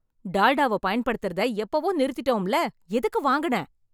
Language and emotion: Tamil, angry